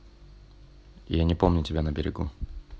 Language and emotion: Russian, neutral